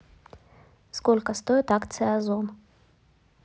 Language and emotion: Russian, neutral